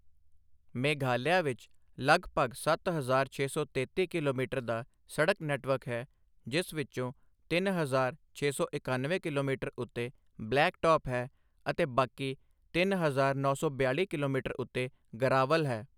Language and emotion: Punjabi, neutral